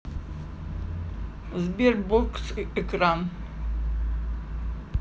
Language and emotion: Russian, neutral